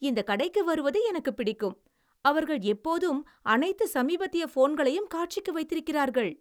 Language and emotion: Tamil, happy